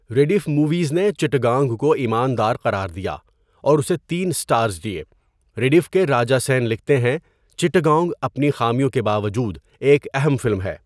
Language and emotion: Urdu, neutral